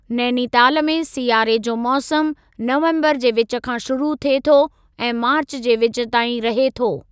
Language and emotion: Sindhi, neutral